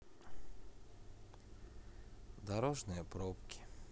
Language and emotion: Russian, sad